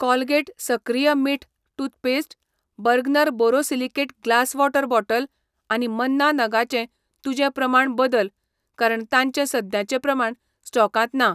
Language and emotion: Goan Konkani, neutral